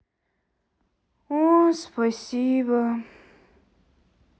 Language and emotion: Russian, sad